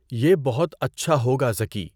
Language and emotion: Urdu, neutral